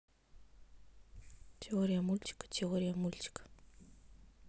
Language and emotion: Russian, neutral